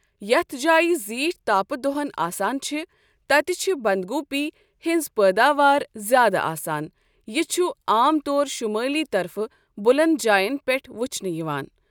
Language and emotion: Kashmiri, neutral